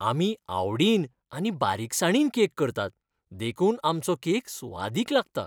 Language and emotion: Goan Konkani, happy